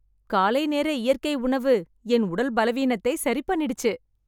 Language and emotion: Tamil, happy